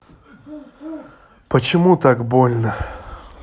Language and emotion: Russian, sad